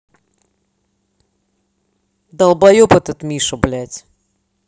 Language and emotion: Russian, angry